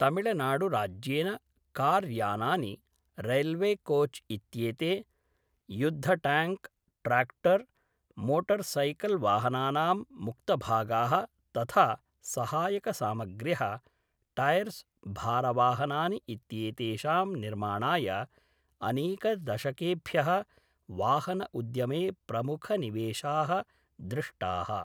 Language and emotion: Sanskrit, neutral